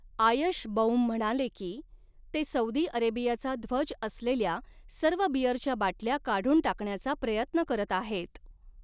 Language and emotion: Marathi, neutral